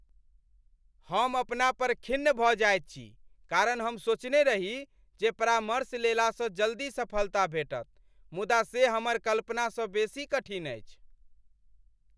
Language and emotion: Maithili, angry